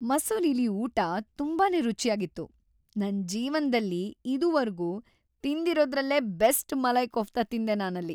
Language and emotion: Kannada, happy